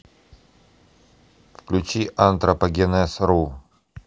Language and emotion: Russian, neutral